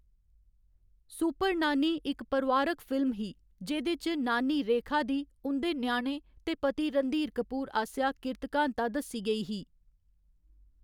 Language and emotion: Dogri, neutral